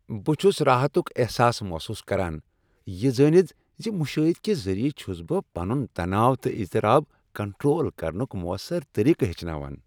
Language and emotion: Kashmiri, happy